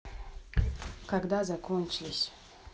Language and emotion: Russian, neutral